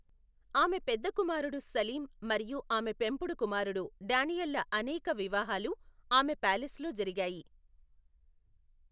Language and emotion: Telugu, neutral